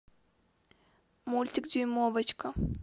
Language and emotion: Russian, neutral